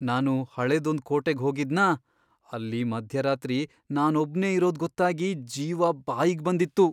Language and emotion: Kannada, fearful